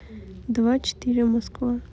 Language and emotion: Russian, neutral